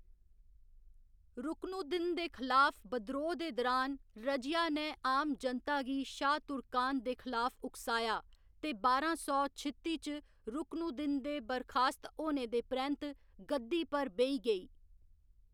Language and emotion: Dogri, neutral